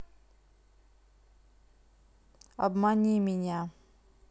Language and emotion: Russian, neutral